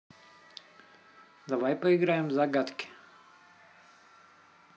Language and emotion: Russian, neutral